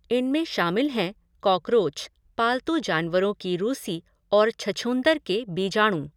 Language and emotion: Hindi, neutral